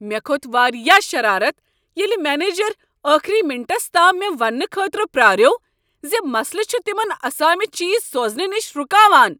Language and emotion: Kashmiri, angry